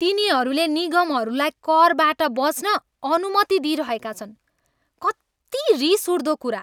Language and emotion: Nepali, angry